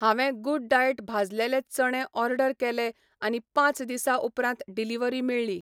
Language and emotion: Goan Konkani, neutral